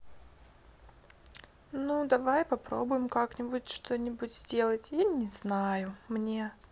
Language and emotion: Russian, sad